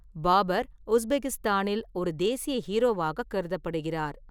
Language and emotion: Tamil, neutral